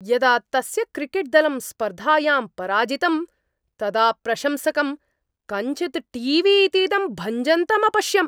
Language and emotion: Sanskrit, angry